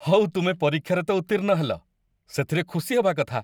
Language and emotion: Odia, happy